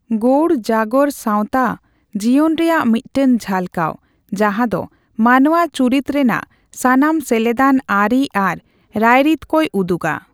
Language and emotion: Santali, neutral